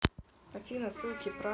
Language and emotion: Russian, neutral